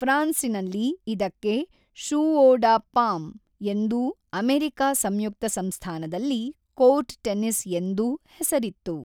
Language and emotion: Kannada, neutral